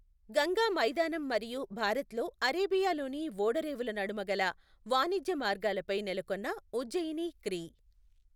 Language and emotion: Telugu, neutral